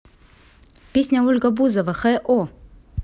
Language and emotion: Russian, neutral